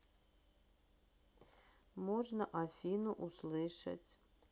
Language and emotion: Russian, neutral